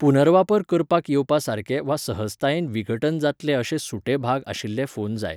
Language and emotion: Goan Konkani, neutral